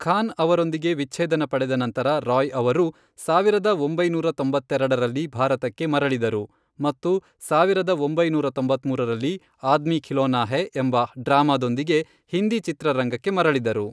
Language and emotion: Kannada, neutral